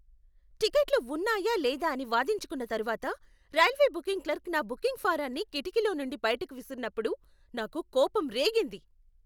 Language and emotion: Telugu, angry